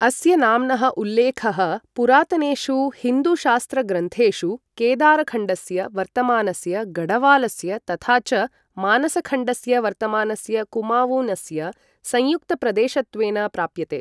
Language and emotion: Sanskrit, neutral